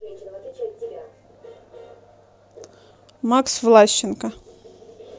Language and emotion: Russian, neutral